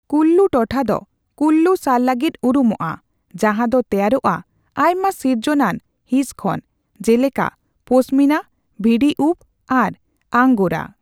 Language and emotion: Santali, neutral